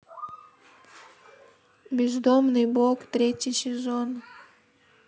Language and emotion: Russian, sad